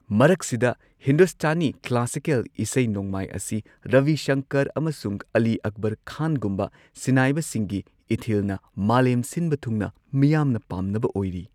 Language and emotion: Manipuri, neutral